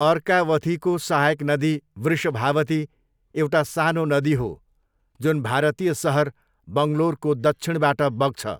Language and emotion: Nepali, neutral